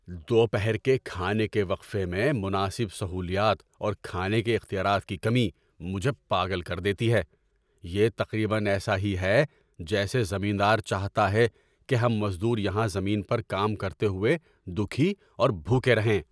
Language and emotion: Urdu, angry